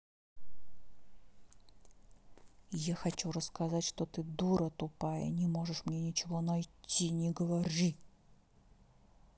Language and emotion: Russian, angry